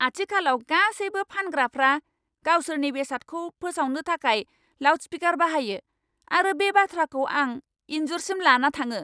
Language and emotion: Bodo, angry